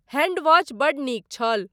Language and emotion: Maithili, neutral